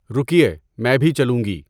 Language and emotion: Urdu, neutral